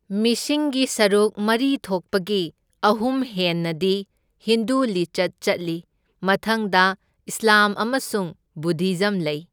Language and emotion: Manipuri, neutral